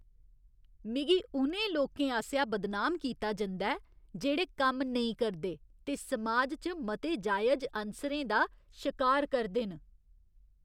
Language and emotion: Dogri, disgusted